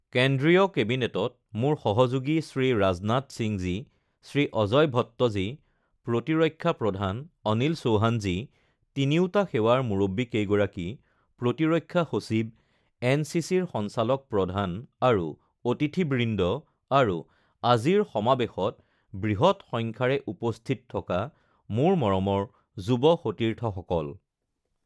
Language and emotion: Assamese, neutral